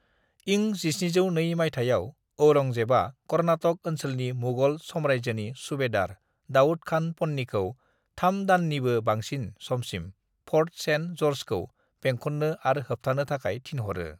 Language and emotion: Bodo, neutral